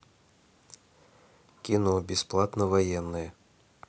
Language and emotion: Russian, neutral